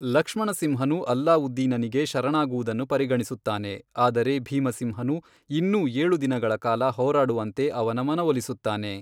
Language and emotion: Kannada, neutral